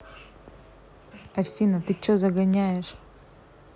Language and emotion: Russian, angry